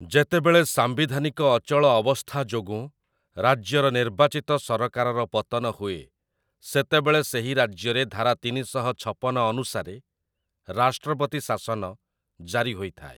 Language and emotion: Odia, neutral